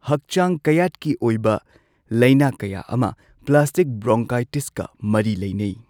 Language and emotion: Manipuri, neutral